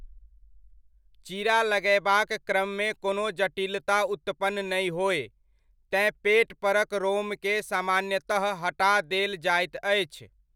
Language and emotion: Maithili, neutral